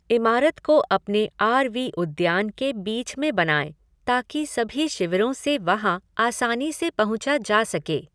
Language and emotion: Hindi, neutral